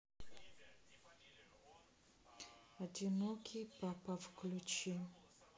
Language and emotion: Russian, neutral